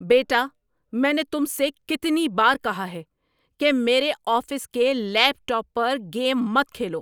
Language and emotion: Urdu, angry